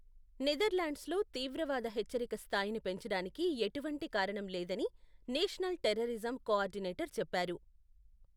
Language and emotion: Telugu, neutral